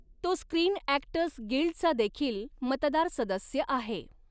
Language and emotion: Marathi, neutral